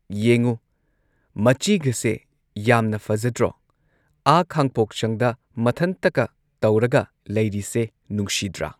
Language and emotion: Manipuri, neutral